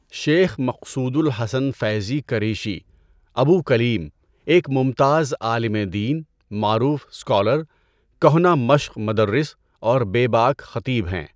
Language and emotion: Urdu, neutral